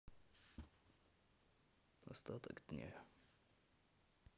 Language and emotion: Russian, neutral